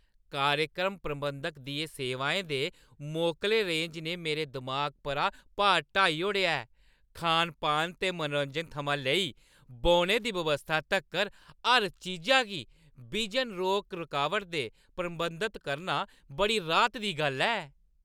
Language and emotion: Dogri, happy